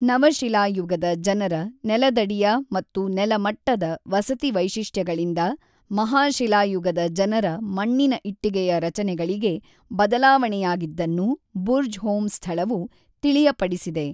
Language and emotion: Kannada, neutral